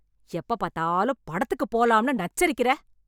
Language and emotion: Tamil, angry